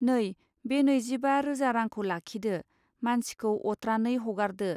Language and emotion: Bodo, neutral